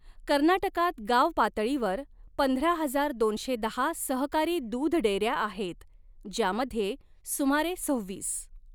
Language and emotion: Marathi, neutral